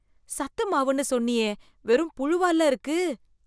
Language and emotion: Tamil, disgusted